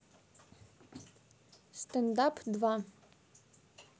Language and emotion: Russian, neutral